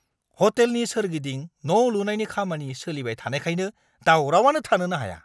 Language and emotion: Bodo, angry